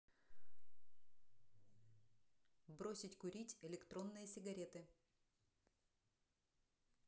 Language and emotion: Russian, neutral